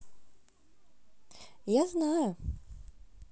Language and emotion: Russian, positive